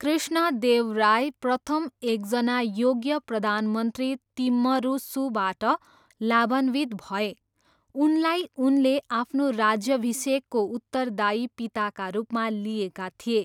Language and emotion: Nepali, neutral